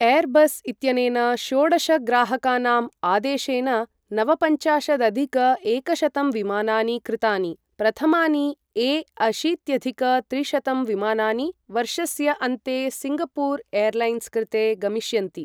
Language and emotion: Sanskrit, neutral